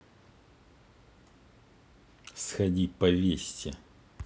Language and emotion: Russian, neutral